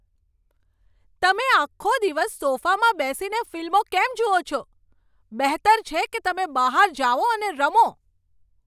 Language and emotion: Gujarati, angry